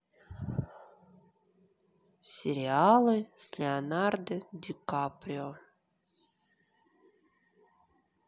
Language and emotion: Russian, sad